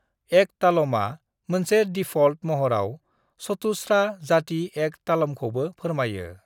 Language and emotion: Bodo, neutral